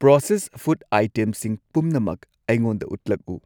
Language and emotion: Manipuri, neutral